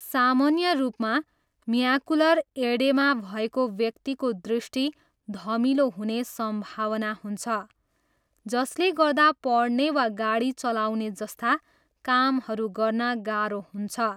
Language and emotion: Nepali, neutral